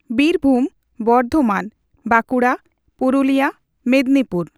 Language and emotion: Santali, neutral